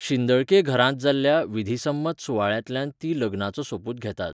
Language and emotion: Goan Konkani, neutral